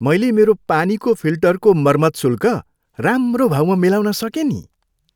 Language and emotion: Nepali, happy